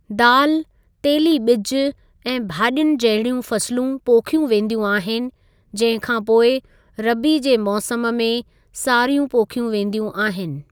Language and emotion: Sindhi, neutral